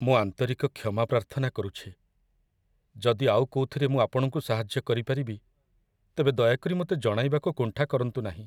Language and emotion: Odia, sad